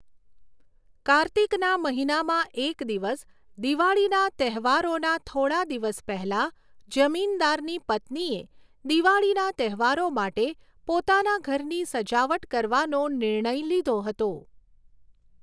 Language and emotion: Gujarati, neutral